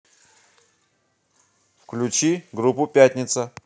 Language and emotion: Russian, neutral